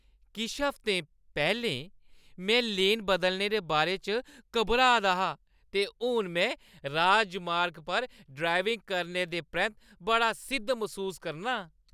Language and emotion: Dogri, happy